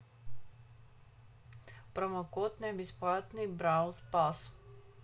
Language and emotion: Russian, neutral